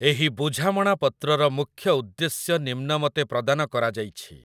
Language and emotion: Odia, neutral